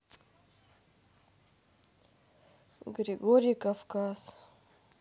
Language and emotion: Russian, neutral